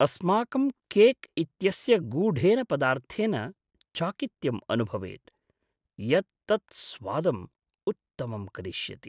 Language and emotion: Sanskrit, surprised